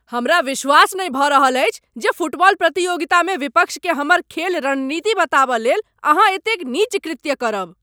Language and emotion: Maithili, angry